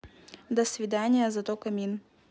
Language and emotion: Russian, neutral